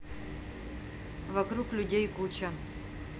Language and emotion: Russian, neutral